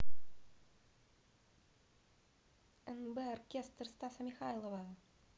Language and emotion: Russian, positive